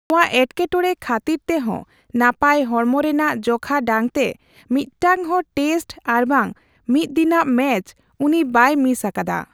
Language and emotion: Santali, neutral